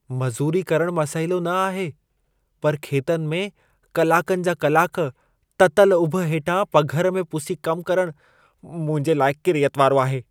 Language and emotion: Sindhi, disgusted